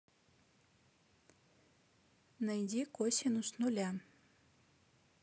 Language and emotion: Russian, neutral